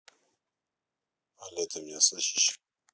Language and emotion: Russian, neutral